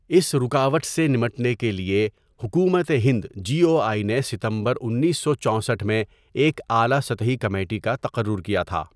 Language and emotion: Urdu, neutral